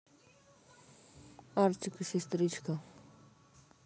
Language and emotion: Russian, neutral